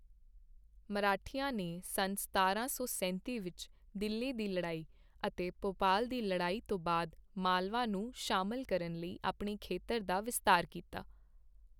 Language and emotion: Punjabi, neutral